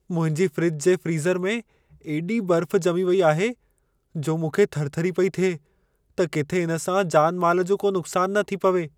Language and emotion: Sindhi, fearful